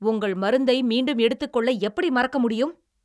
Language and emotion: Tamil, angry